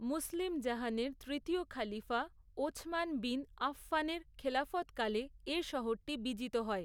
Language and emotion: Bengali, neutral